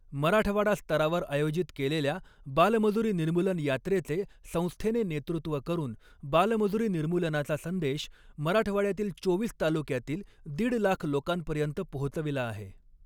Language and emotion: Marathi, neutral